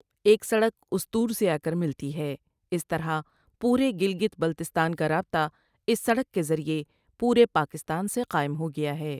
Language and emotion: Urdu, neutral